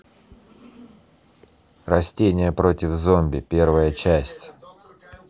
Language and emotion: Russian, neutral